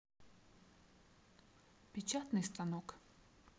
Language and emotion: Russian, neutral